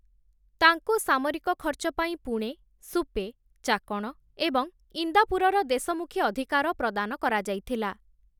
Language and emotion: Odia, neutral